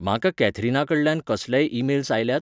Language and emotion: Goan Konkani, neutral